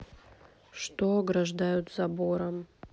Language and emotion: Russian, neutral